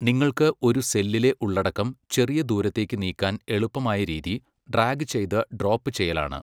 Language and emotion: Malayalam, neutral